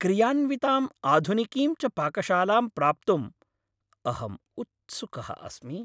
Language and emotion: Sanskrit, happy